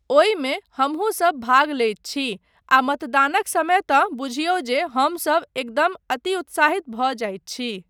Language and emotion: Maithili, neutral